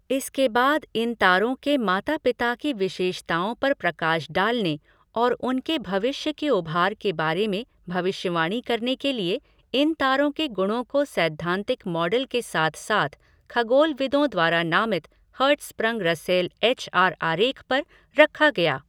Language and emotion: Hindi, neutral